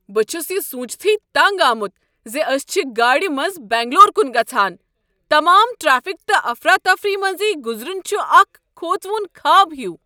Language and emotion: Kashmiri, angry